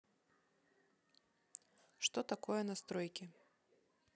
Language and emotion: Russian, neutral